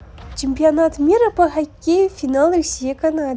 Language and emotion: Russian, positive